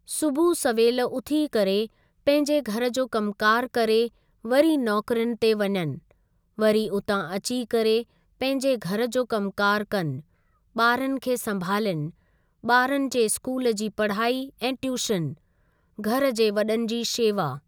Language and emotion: Sindhi, neutral